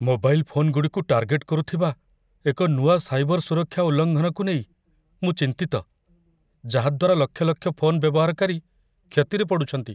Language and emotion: Odia, fearful